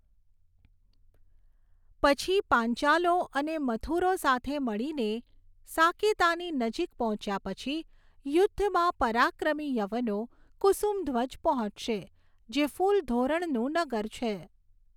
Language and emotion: Gujarati, neutral